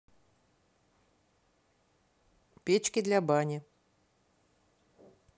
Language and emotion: Russian, neutral